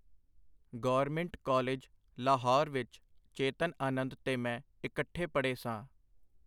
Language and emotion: Punjabi, neutral